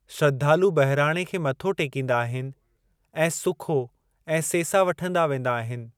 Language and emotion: Sindhi, neutral